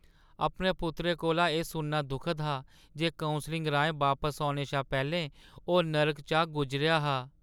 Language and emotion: Dogri, sad